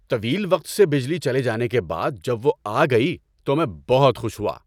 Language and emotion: Urdu, happy